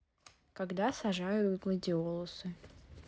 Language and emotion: Russian, neutral